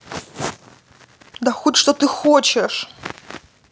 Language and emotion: Russian, angry